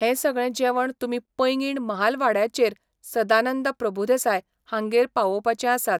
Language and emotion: Goan Konkani, neutral